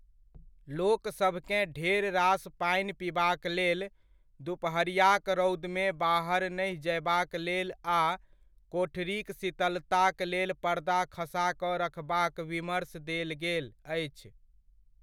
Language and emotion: Maithili, neutral